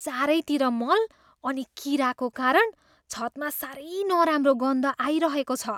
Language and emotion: Nepali, disgusted